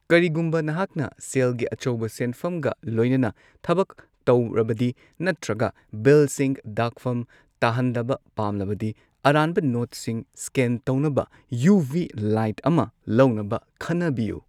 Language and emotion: Manipuri, neutral